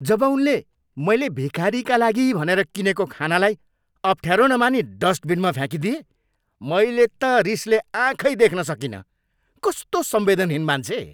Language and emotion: Nepali, angry